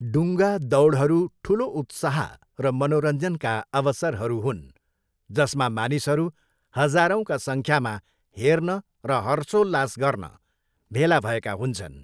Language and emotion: Nepali, neutral